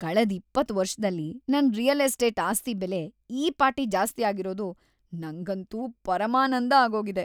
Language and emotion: Kannada, happy